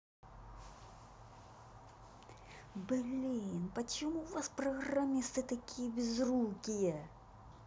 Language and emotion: Russian, angry